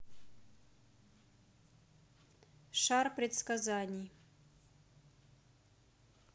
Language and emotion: Russian, neutral